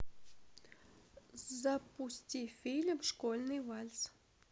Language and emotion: Russian, neutral